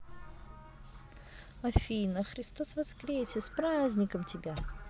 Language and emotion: Russian, positive